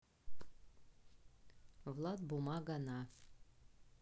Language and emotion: Russian, neutral